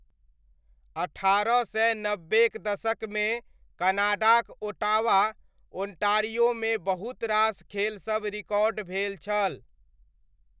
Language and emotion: Maithili, neutral